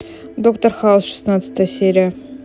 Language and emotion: Russian, neutral